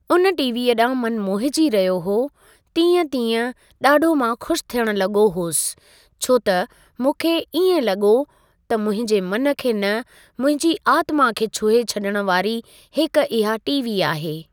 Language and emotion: Sindhi, neutral